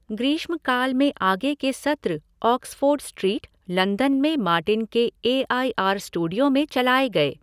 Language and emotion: Hindi, neutral